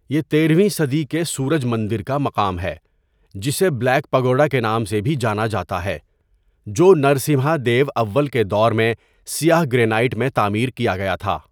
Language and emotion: Urdu, neutral